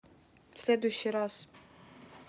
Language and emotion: Russian, neutral